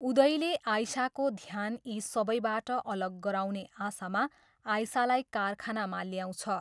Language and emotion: Nepali, neutral